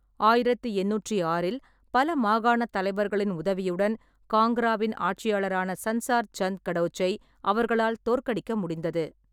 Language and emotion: Tamil, neutral